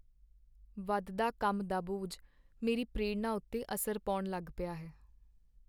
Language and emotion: Punjabi, sad